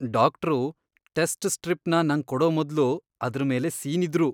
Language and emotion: Kannada, disgusted